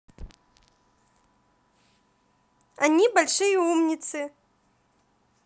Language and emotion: Russian, positive